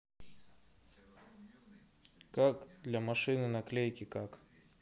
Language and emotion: Russian, neutral